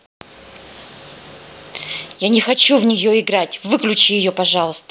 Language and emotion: Russian, angry